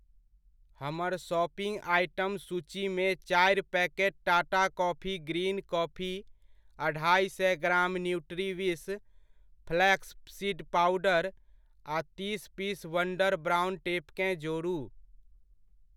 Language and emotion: Maithili, neutral